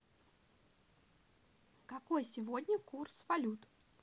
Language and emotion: Russian, positive